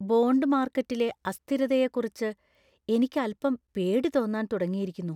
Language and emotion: Malayalam, fearful